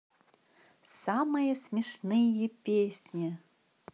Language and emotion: Russian, positive